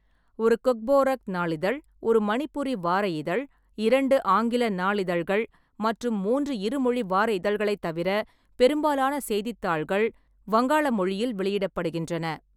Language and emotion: Tamil, neutral